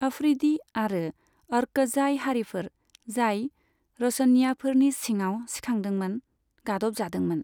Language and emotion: Bodo, neutral